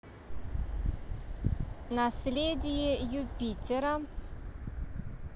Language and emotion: Russian, neutral